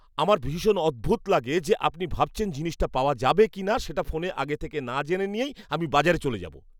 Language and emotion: Bengali, disgusted